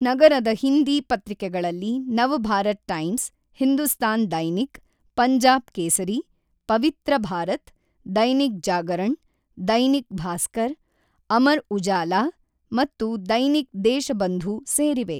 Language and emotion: Kannada, neutral